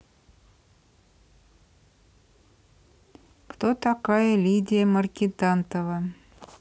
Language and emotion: Russian, neutral